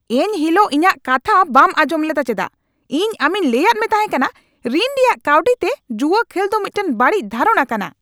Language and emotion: Santali, angry